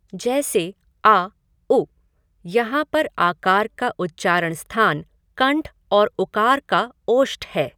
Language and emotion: Hindi, neutral